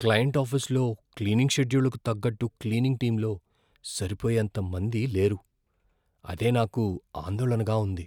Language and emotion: Telugu, fearful